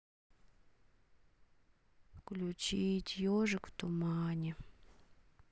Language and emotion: Russian, sad